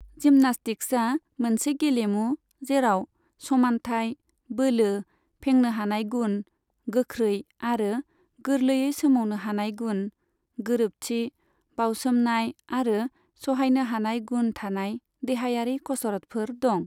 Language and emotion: Bodo, neutral